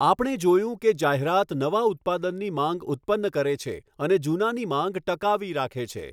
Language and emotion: Gujarati, neutral